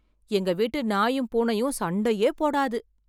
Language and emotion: Tamil, surprised